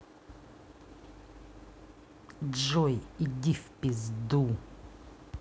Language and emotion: Russian, angry